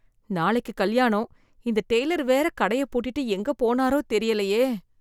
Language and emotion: Tamil, fearful